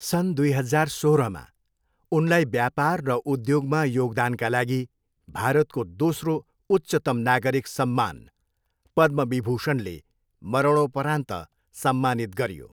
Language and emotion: Nepali, neutral